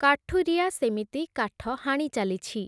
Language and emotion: Odia, neutral